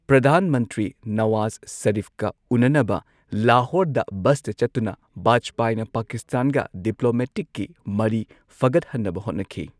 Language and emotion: Manipuri, neutral